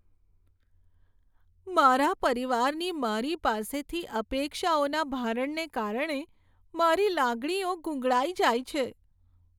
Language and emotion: Gujarati, sad